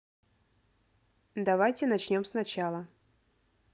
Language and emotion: Russian, neutral